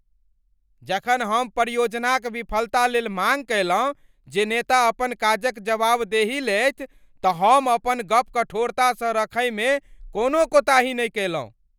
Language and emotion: Maithili, angry